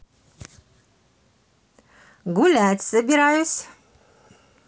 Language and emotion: Russian, positive